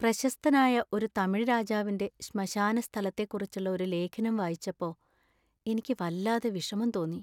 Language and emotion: Malayalam, sad